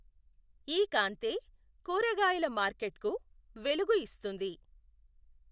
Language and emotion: Telugu, neutral